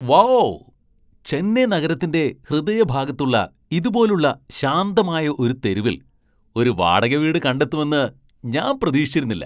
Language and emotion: Malayalam, surprised